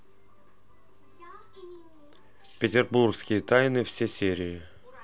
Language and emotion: Russian, neutral